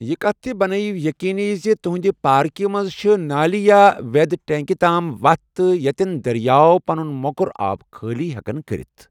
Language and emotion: Kashmiri, neutral